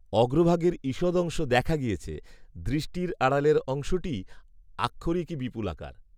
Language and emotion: Bengali, neutral